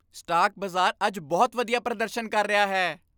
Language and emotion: Punjabi, happy